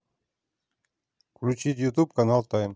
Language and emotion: Russian, neutral